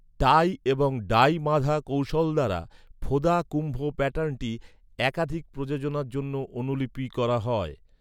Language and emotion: Bengali, neutral